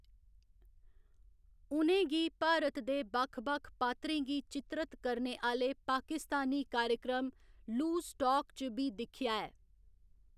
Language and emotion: Dogri, neutral